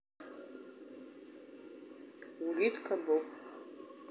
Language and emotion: Russian, neutral